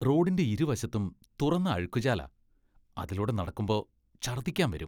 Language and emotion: Malayalam, disgusted